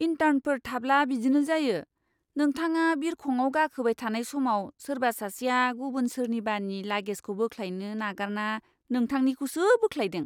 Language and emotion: Bodo, disgusted